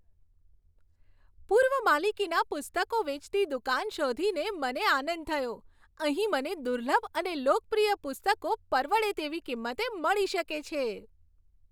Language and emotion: Gujarati, happy